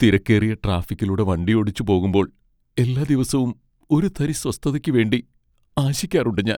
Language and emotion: Malayalam, sad